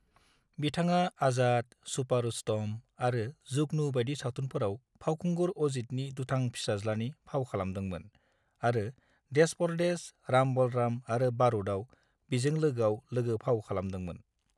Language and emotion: Bodo, neutral